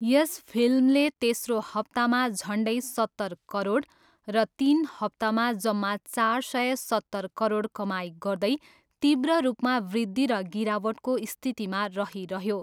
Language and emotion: Nepali, neutral